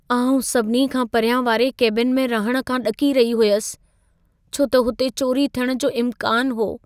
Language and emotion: Sindhi, fearful